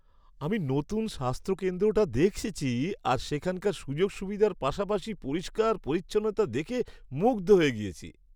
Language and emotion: Bengali, happy